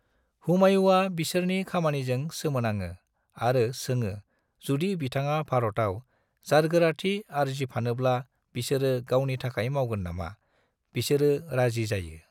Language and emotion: Bodo, neutral